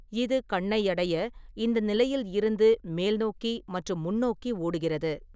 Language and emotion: Tamil, neutral